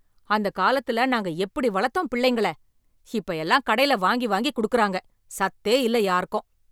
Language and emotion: Tamil, angry